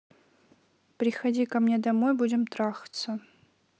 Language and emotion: Russian, neutral